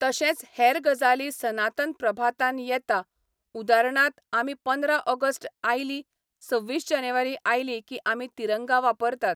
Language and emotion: Goan Konkani, neutral